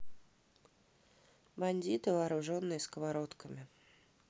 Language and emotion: Russian, neutral